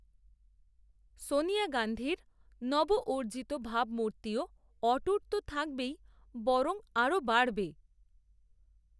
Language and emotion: Bengali, neutral